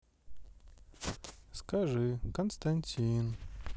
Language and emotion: Russian, sad